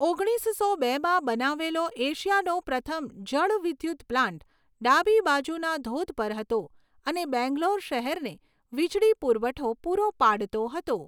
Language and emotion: Gujarati, neutral